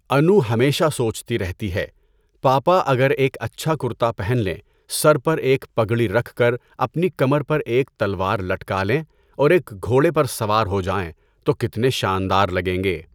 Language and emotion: Urdu, neutral